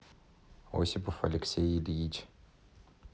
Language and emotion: Russian, neutral